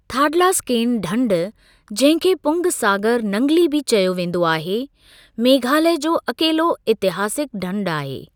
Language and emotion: Sindhi, neutral